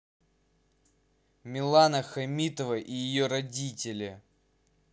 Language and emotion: Russian, angry